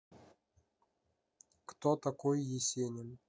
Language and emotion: Russian, neutral